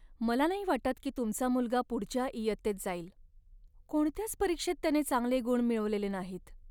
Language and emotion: Marathi, sad